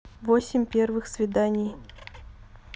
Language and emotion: Russian, neutral